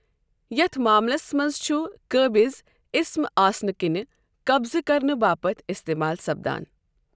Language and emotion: Kashmiri, neutral